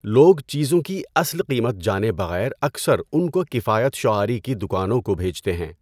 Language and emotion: Urdu, neutral